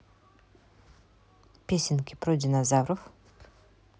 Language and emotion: Russian, neutral